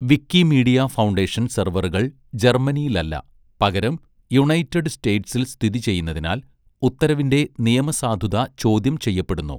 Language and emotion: Malayalam, neutral